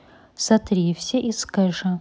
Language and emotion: Russian, neutral